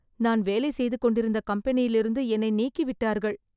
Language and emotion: Tamil, sad